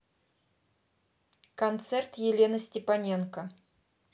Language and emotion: Russian, neutral